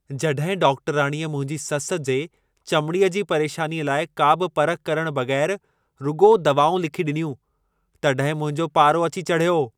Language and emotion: Sindhi, angry